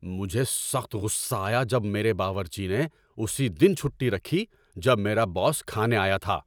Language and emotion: Urdu, angry